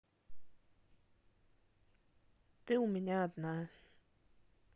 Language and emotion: Russian, neutral